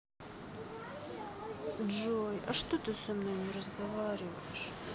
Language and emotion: Russian, sad